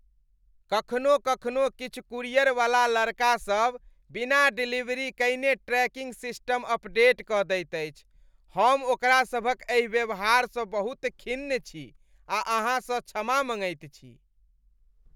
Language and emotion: Maithili, disgusted